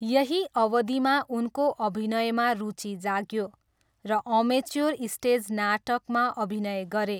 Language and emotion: Nepali, neutral